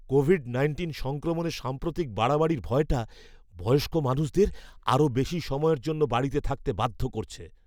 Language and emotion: Bengali, fearful